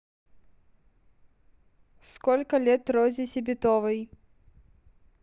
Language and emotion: Russian, neutral